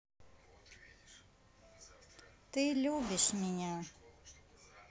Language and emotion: Russian, neutral